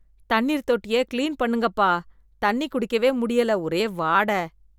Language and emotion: Tamil, disgusted